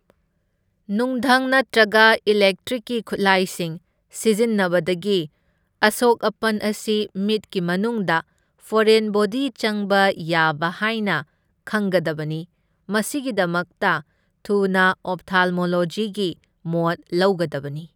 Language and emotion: Manipuri, neutral